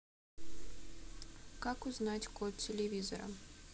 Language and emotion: Russian, neutral